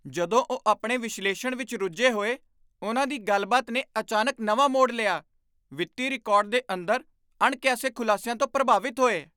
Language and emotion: Punjabi, surprised